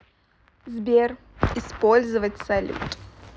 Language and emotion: Russian, neutral